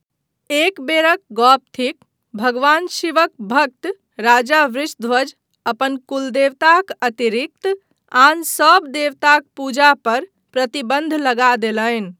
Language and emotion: Maithili, neutral